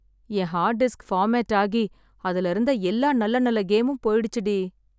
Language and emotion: Tamil, sad